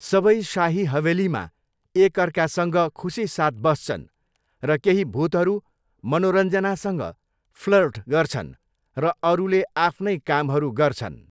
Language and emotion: Nepali, neutral